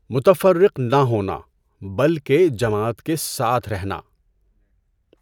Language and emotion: Urdu, neutral